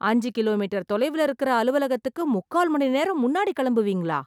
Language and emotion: Tamil, surprised